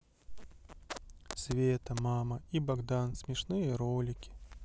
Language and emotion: Russian, sad